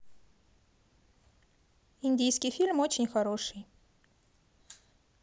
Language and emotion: Russian, positive